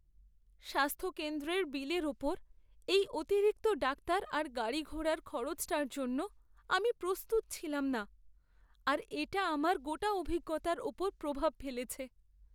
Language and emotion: Bengali, sad